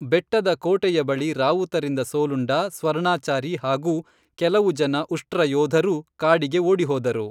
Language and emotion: Kannada, neutral